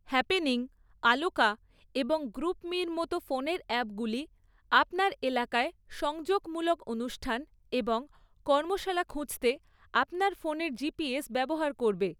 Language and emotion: Bengali, neutral